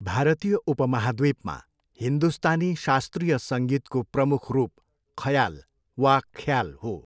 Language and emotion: Nepali, neutral